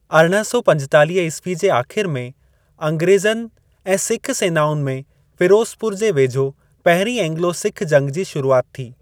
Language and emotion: Sindhi, neutral